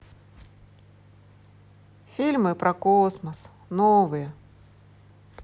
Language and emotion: Russian, positive